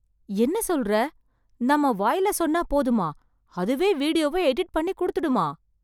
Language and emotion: Tamil, surprised